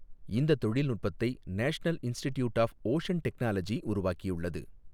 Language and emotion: Tamil, neutral